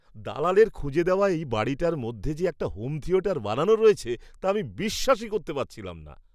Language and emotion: Bengali, surprised